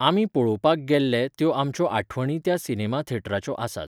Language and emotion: Goan Konkani, neutral